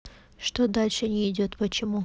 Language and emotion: Russian, neutral